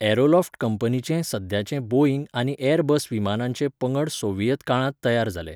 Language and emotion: Goan Konkani, neutral